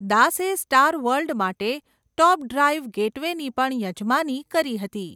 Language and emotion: Gujarati, neutral